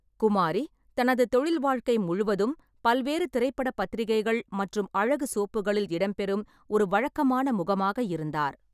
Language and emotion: Tamil, neutral